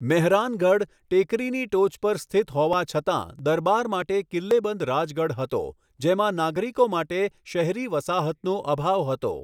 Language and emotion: Gujarati, neutral